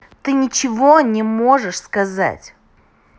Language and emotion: Russian, angry